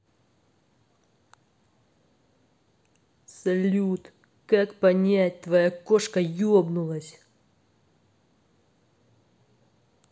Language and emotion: Russian, angry